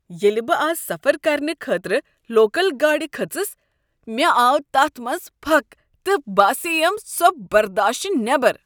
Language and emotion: Kashmiri, disgusted